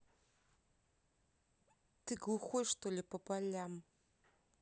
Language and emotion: Russian, angry